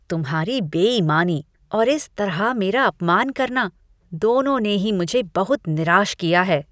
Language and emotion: Hindi, disgusted